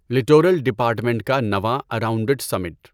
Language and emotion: Urdu, neutral